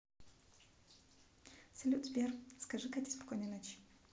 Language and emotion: Russian, neutral